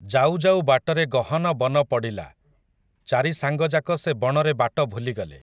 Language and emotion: Odia, neutral